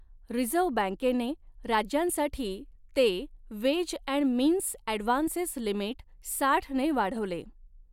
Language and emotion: Marathi, neutral